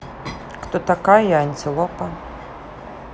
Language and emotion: Russian, neutral